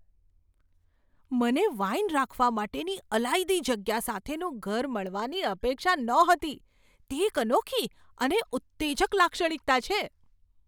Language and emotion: Gujarati, surprised